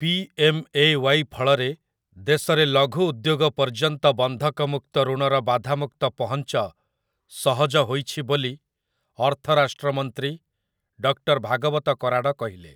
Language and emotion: Odia, neutral